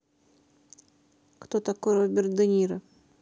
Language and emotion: Russian, neutral